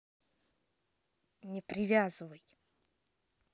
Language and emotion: Russian, angry